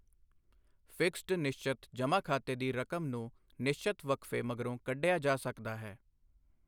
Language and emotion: Punjabi, neutral